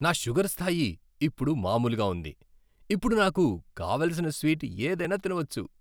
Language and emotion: Telugu, happy